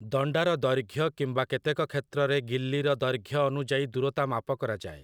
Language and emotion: Odia, neutral